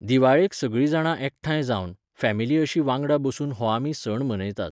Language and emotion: Goan Konkani, neutral